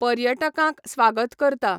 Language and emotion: Goan Konkani, neutral